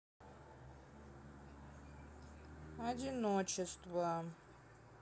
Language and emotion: Russian, sad